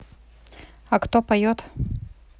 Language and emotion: Russian, neutral